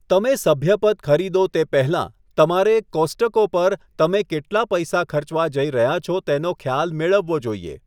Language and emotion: Gujarati, neutral